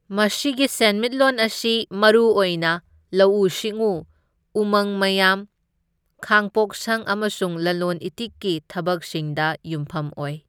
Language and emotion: Manipuri, neutral